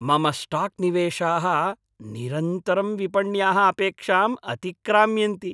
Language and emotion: Sanskrit, happy